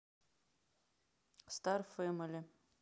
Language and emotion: Russian, neutral